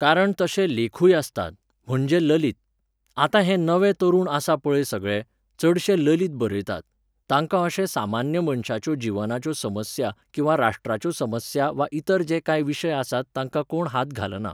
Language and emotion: Goan Konkani, neutral